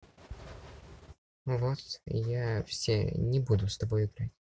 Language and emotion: Russian, neutral